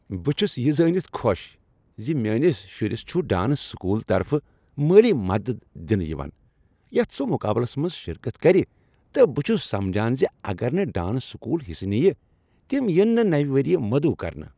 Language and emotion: Kashmiri, happy